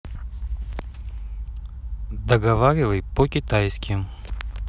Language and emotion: Russian, neutral